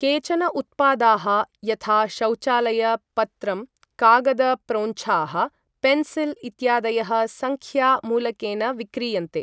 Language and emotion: Sanskrit, neutral